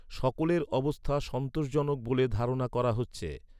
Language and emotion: Bengali, neutral